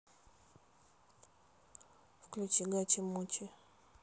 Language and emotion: Russian, neutral